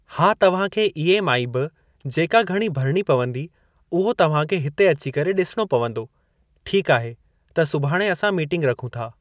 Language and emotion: Sindhi, neutral